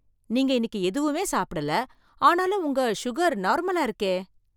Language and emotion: Tamil, surprised